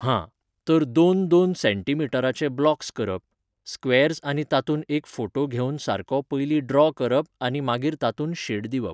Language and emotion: Goan Konkani, neutral